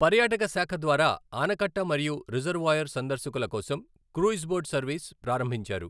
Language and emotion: Telugu, neutral